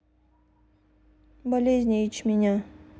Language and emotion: Russian, neutral